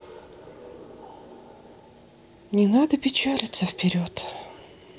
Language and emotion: Russian, sad